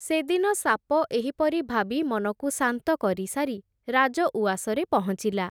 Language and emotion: Odia, neutral